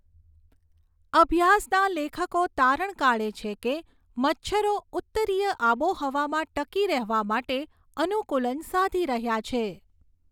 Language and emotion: Gujarati, neutral